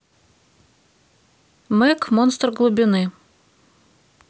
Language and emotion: Russian, neutral